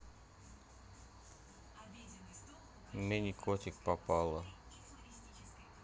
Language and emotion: Russian, sad